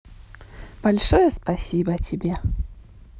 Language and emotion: Russian, positive